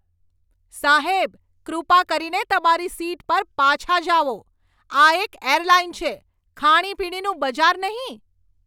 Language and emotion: Gujarati, angry